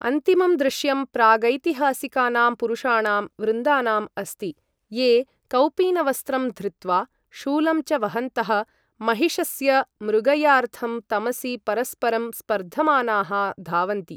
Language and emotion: Sanskrit, neutral